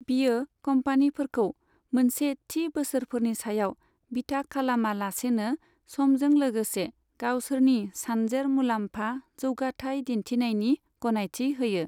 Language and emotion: Bodo, neutral